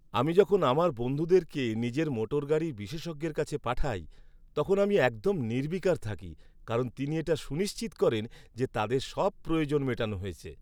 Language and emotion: Bengali, happy